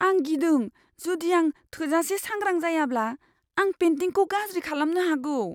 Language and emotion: Bodo, fearful